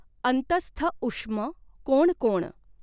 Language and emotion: Marathi, neutral